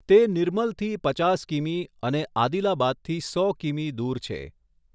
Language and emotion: Gujarati, neutral